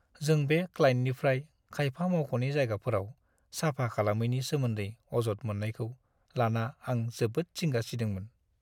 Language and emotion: Bodo, sad